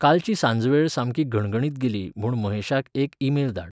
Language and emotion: Goan Konkani, neutral